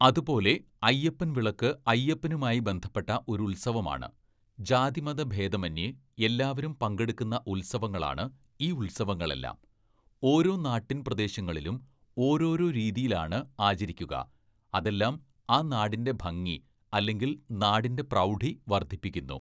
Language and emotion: Malayalam, neutral